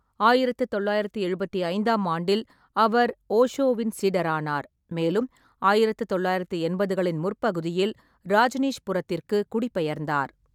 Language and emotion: Tamil, neutral